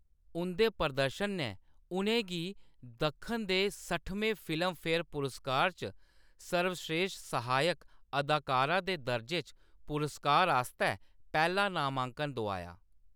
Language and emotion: Dogri, neutral